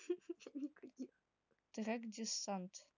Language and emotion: Russian, neutral